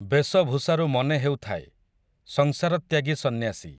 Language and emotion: Odia, neutral